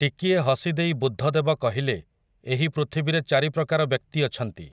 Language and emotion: Odia, neutral